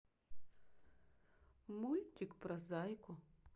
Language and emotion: Russian, neutral